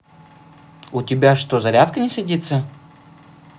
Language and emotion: Russian, neutral